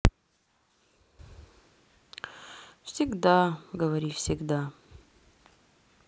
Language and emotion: Russian, sad